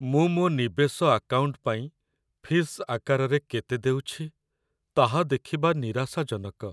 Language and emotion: Odia, sad